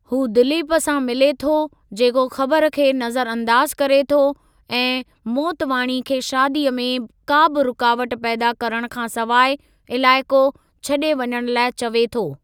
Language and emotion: Sindhi, neutral